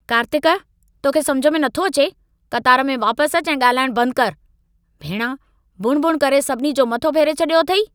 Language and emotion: Sindhi, angry